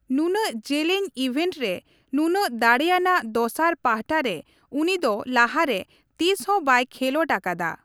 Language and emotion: Santali, neutral